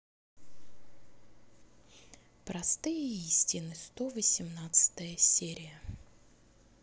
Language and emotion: Russian, neutral